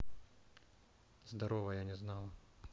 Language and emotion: Russian, neutral